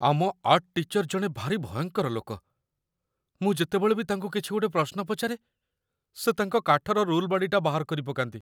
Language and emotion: Odia, fearful